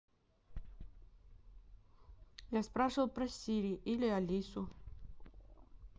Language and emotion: Russian, neutral